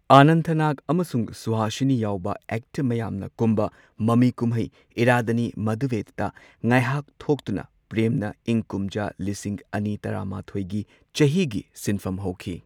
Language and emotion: Manipuri, neutral